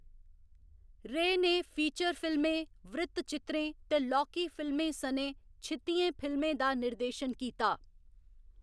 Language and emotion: Dogri, neutral